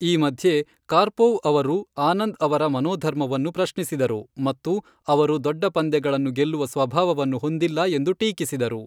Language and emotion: Kannada, neutral